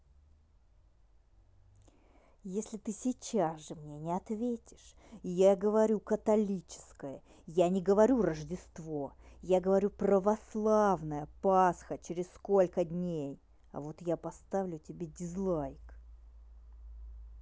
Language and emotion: Russian, angry